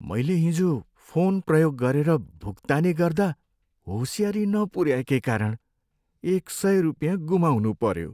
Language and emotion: Nepali, sad